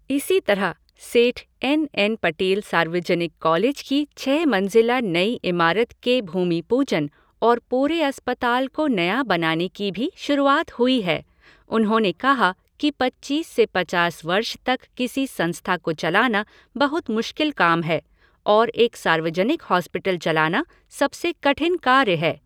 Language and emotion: Hindi, neutral